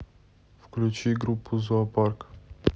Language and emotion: Russian, neutral